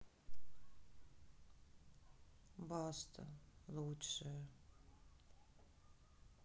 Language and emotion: Russian, sad